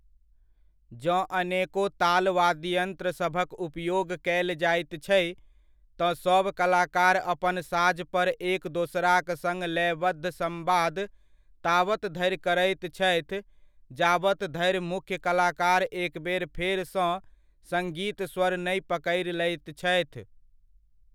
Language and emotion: Maithili, neutral